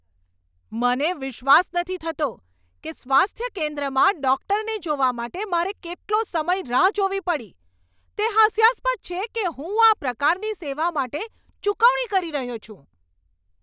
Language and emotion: Gujarati, angry